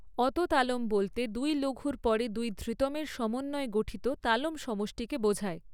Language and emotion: Bengali, neutral